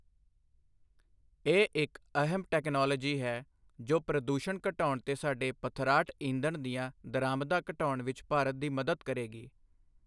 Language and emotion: Punjabi, neutral